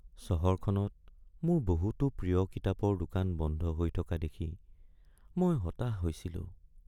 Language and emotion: Assamese, sad